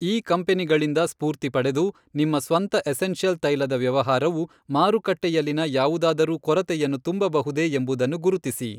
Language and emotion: Kannada, neutral